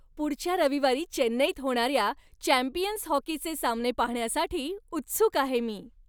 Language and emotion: Marathi, happy